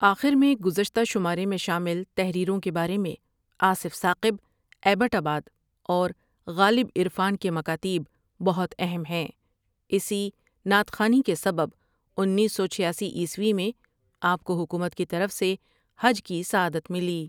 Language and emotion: Urdu, neutral